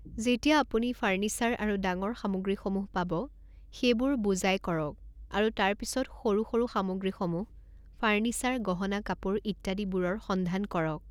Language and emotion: Assamese, neutral